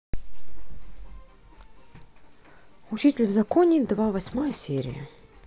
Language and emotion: Russian, neutral